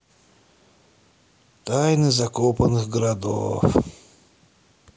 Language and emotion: Russian, sad